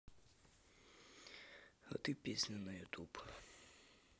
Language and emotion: Russian, sad